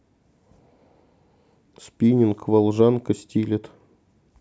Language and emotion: Russian, neutral